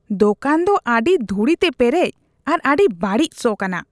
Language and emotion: Santali, disgusted